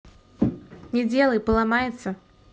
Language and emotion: Russian, neutral